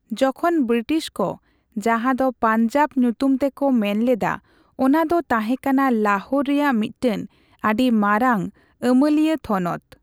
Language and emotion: Santali, neutral